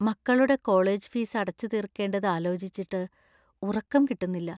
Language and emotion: Malayalam, fearful